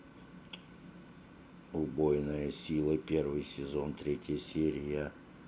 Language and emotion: Russian, neutral